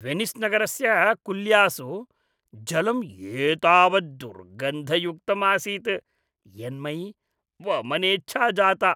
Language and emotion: Sanskrit, disgusted